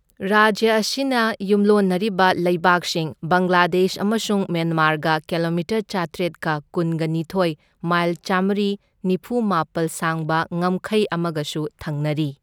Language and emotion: Manipuri, neutral